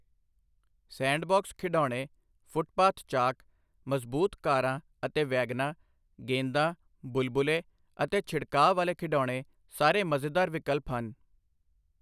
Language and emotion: Punjabi, neutral